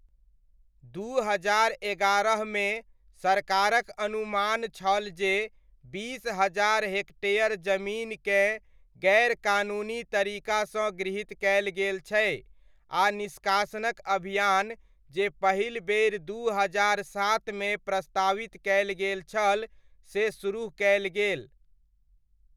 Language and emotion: Maithili, neutral